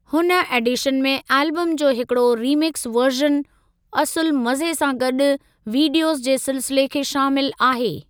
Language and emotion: Sindhi, neutral